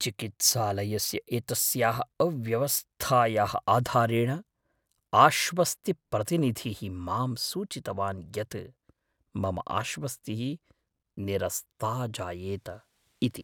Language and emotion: Sanskrit, fearful